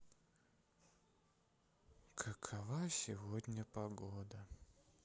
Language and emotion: Russian, sad